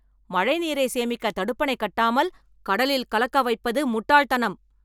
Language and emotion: Tamil, angry